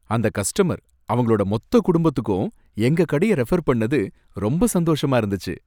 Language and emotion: Tamil, happy